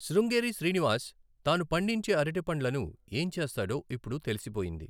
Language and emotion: Telugu, neutral